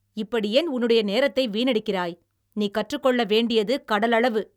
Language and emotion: Tamil, angry